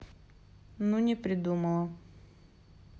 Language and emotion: Russian, sad